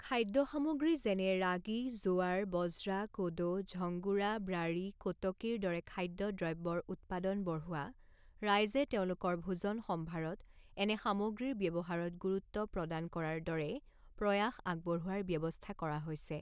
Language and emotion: Assamese, neutral